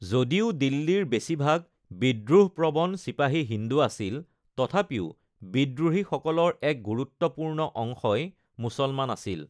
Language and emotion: Assamese, neutral